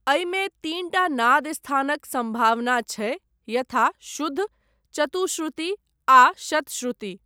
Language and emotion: Maithili, neutral